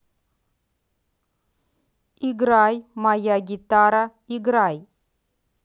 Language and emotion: Russian, neutral